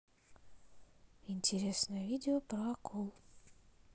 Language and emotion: Russian, neutral